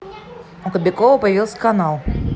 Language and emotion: Russian, neutral